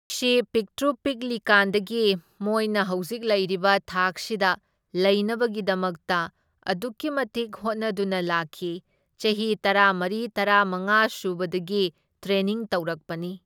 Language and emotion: Manipuri, neutral